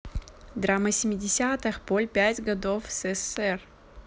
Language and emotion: Russian, neutral